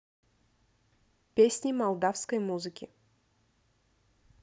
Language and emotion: Russian, neutral